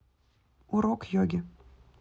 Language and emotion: Russian, neutral